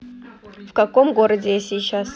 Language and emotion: Russian, neutral